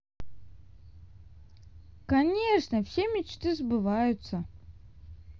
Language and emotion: Russian, positive